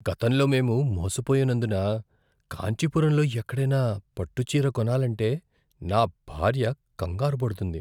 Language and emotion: Telugu, fearful